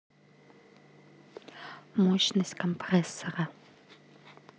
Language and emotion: Russian, neutral